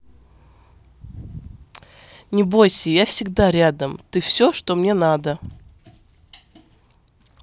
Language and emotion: Russian, positive